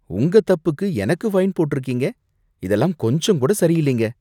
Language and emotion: Tamil, disgusted